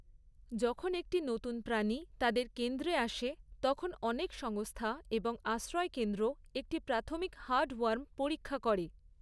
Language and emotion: Bengali, neutral